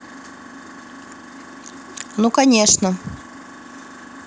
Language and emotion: Russian, neutral